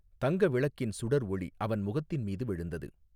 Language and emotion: Tamil, neutral